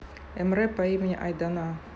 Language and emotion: Russian, neutral